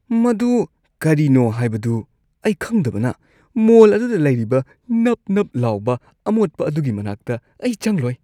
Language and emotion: Manipuri, disgusted